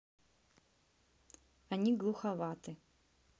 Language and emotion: Russian, neutral